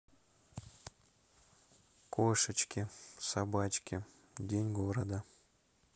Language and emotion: Russian, neutral